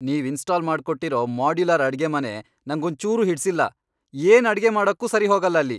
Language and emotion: Kannada, angry